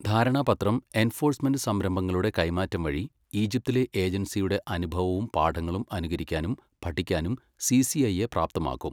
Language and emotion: Malayalam, neutral